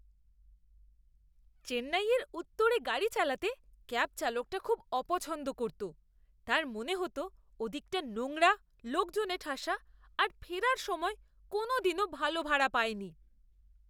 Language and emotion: Bengali, disgusted